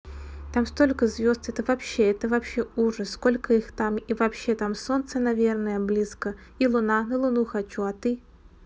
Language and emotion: Russian, neutral